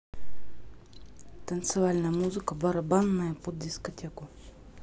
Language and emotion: Russian, neutral